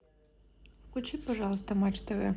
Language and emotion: Russian, neutral